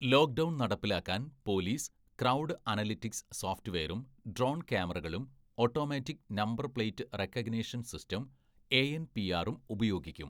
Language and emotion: Malayalam, neutral